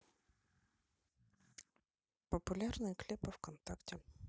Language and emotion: Russian, neutral